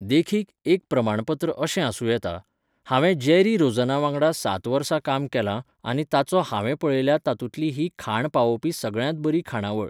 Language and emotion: Goan Konkani, neutral